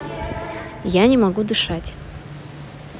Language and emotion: Russian, neutral